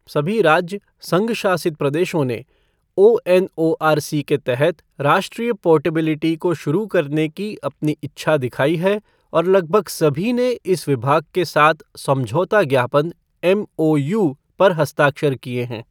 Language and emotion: Hindi, neutral